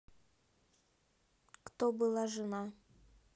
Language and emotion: Russian, neutral